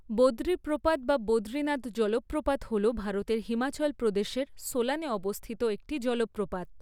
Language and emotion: Bengali, neutral